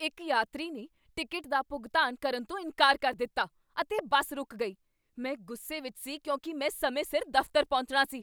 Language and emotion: Punjabi, angry